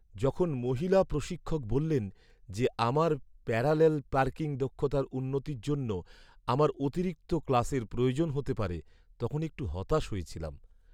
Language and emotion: Bengali, sad